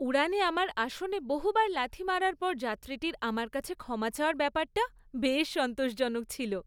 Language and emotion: Bengali, happy